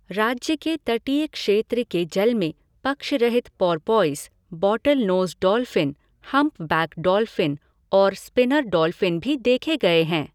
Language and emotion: Hindi, neutral